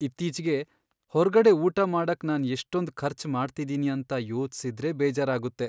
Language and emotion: Kannada, sad